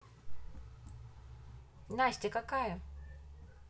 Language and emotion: Russian, neutral